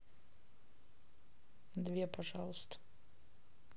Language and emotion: Russian, neutral